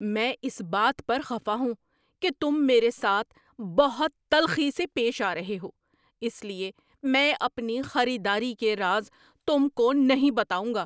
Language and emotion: Urdu, angry